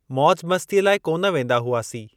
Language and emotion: Sindhi, neutral